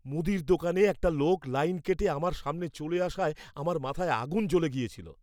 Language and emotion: Bengali, angry